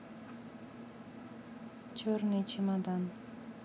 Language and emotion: Russian, neutral